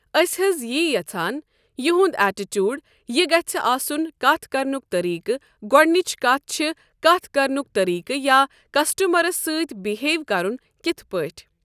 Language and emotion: Kashmiri, neutral